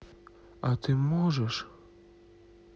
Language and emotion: Russian, sad